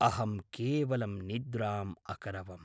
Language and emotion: Sanskrit, neutral